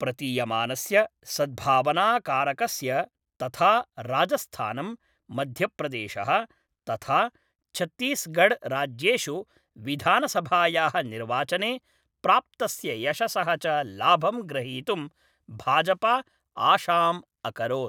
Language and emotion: Sanskrit, neutral